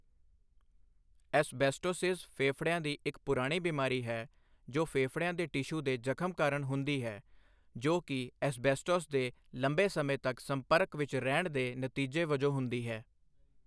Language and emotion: Punjabi, neutral